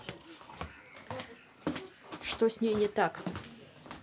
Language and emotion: Russian, angry